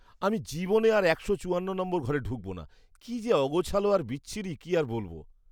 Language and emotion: Bengali, disgusted